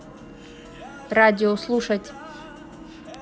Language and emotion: Russian, neutral